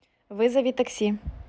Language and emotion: Russian, neutral